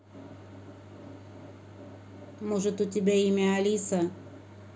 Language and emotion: Russian, neutral